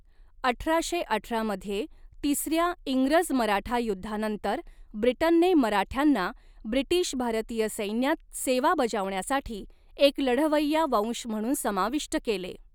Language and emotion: Marathi, neutral